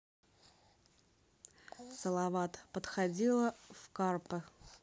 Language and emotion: Russian, neutral